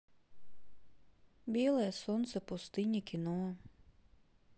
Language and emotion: Russian, sad